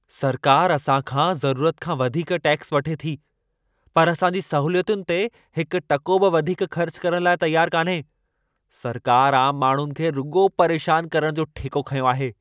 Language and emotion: Sindhi, angry